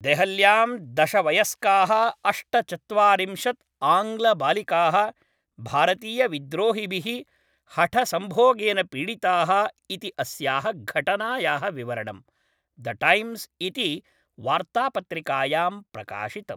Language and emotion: Sanskrit, neutral